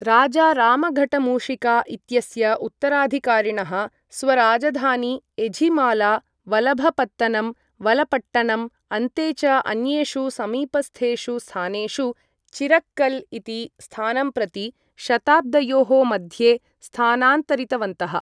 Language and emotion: Sanskrit, neutral